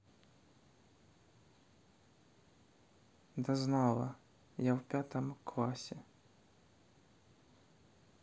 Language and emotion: Russian, sad